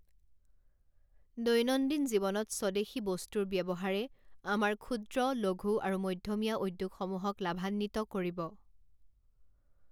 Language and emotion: Assamese, neutral